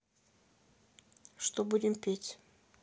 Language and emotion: Russian, neutral